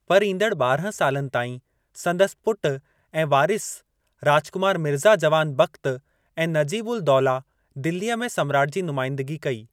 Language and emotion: Sindhi, neutral